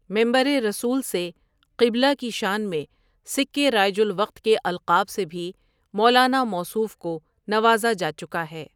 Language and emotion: Urdu, neutral